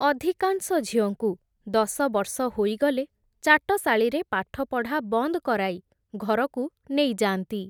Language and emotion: Odia, neutral